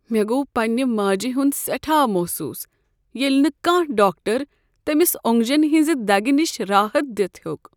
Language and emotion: Kashmiri, sad